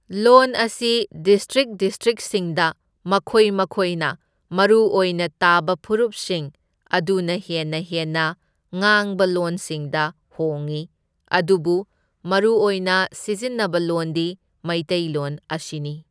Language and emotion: Manipuri, neutral